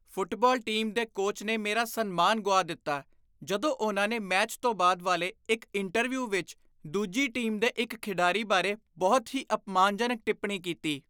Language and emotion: Punjabi, disgusted